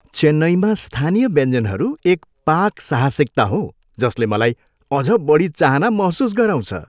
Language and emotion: Nepali, happy